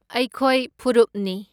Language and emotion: Manipuri, neutral